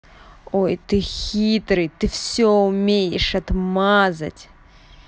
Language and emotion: Russian, angry